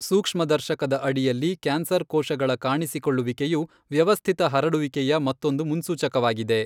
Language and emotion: Kannada, neutral